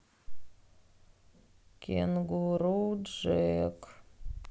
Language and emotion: Russian, sad